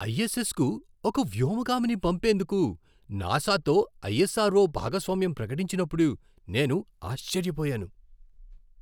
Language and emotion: Telugu, surprised